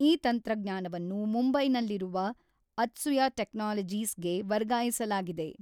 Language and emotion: Kannada, neutral